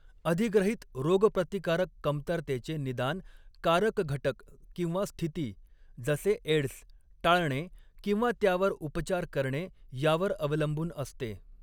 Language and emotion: Marathi, neutral